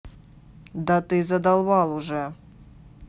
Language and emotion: Russian, angry